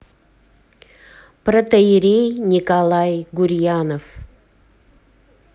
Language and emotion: Russian, neutral